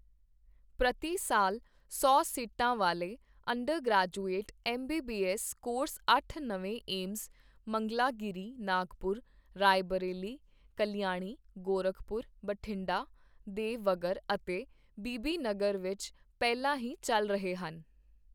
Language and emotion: Punjabi, neutral